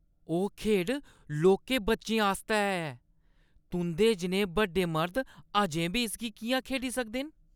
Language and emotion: Dogri, disgusted